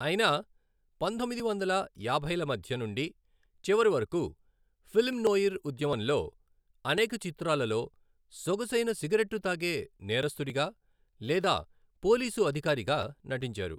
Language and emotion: Telugu, neutral